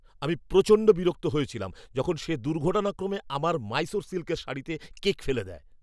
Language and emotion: Bengali, angry